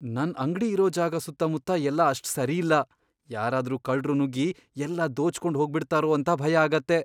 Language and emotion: Kannada, fearful